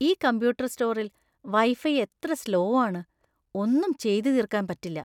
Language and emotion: Malayalam, disgusted